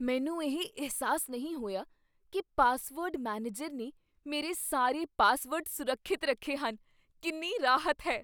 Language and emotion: Punjabi, surprised